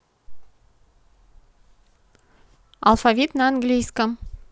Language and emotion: Russian, neutral